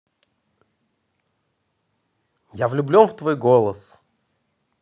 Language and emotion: Russian, positive